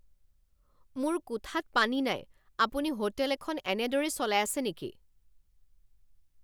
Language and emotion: Assamese, angry